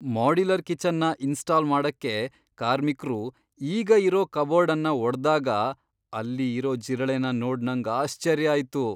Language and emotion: Kannada, surprised